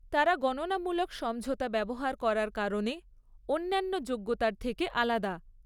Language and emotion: Bengali, neutral